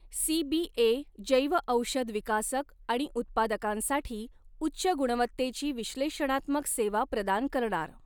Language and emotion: Marathi, neutral